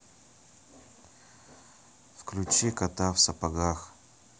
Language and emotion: Russian, neutral